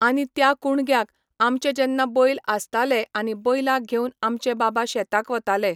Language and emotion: Goan Konkani, neutral